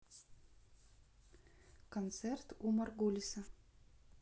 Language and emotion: Russian, neutral